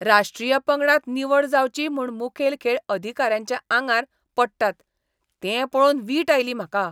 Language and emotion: Goan Konkani, disgusted